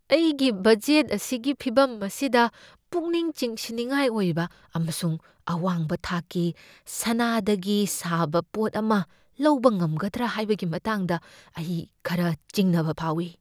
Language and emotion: Manipuri, fearful